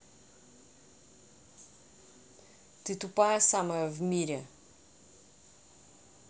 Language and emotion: Russian, angry